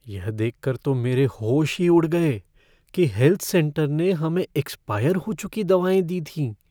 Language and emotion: Hindi, fearful